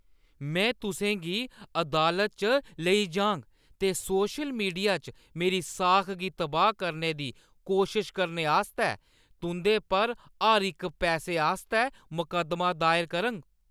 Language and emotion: Dogri, angry